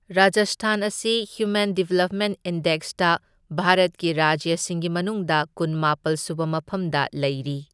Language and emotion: Manipuri, neutral